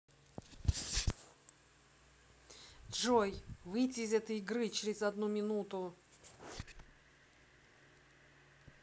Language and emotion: Russian, angry